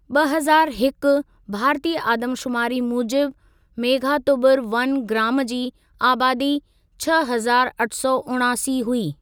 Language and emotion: Sindhi, neutral